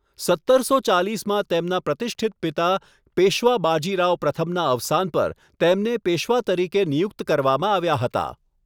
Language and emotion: Gujarati, neutral